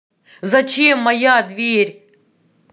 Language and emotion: Russian, angry